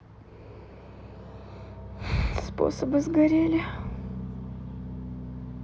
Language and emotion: Russian, sad